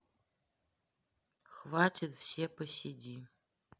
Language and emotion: Russian, neutral